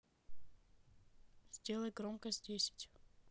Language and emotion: Russian, neutral